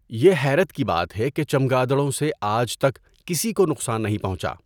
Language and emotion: Urdu, neutral